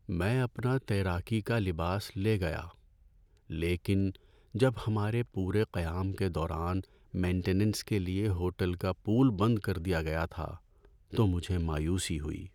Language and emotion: Urdu, sad